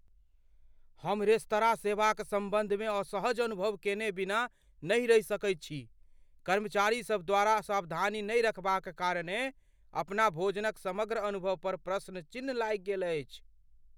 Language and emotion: Maithili, fearful